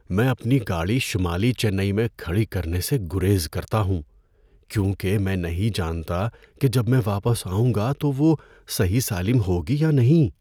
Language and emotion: Urdu, fearful